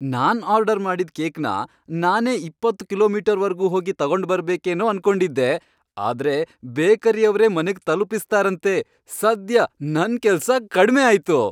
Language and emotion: Kannada, happy